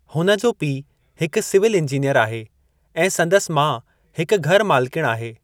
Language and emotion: Sindhi, neutral